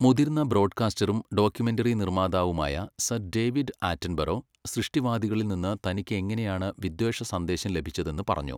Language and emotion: Malayalam, neutral